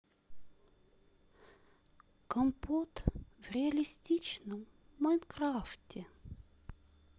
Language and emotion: Russian, sad